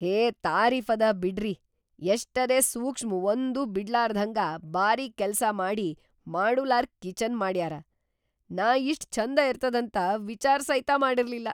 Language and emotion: Kannada, surprised